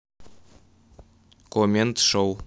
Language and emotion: Russian, neutral